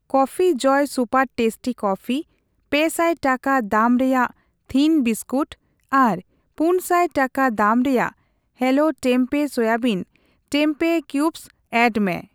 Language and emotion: Santali, neutral